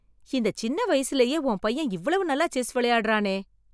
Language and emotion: Tamil, surprised